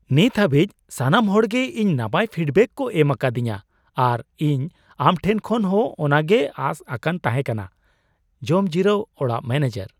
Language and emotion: Santali, surprised